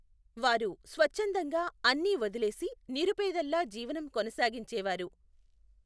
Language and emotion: Telugu, neutral